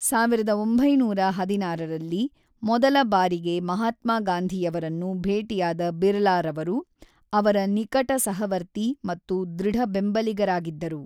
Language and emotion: Kannada, neutral